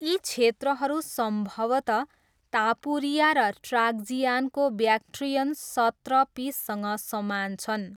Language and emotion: Nepali, neutral